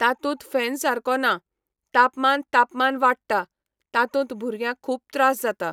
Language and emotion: Goan Konkani, neutral